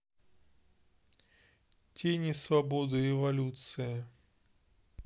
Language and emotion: Russian, neutral